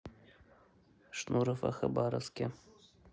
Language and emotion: Russian, neutral